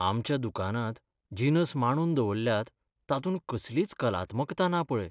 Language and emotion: Goan Konkani, sad